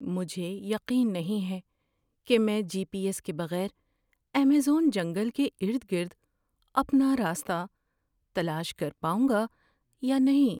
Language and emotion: Urdu, fearful